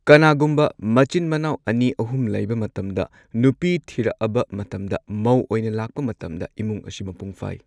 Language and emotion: Manipuri, neutral